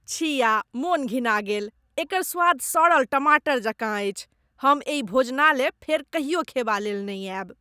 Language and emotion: Maithili, disgusted